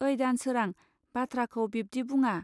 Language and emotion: Bodo, neutral